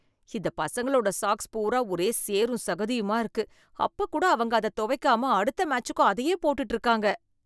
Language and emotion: Tamil, disgusted